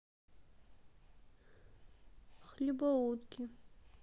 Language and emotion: Russian, sad